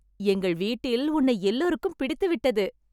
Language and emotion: Tamil, happy